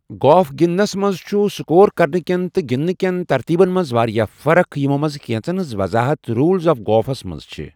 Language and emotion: Kashmiri, neutral